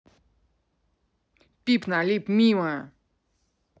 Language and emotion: Russian, angry